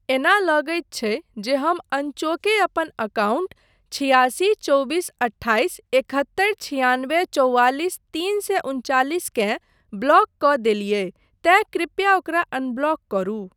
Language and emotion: Maithili, neutral